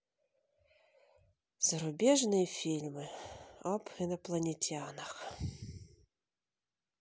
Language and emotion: Russian, sad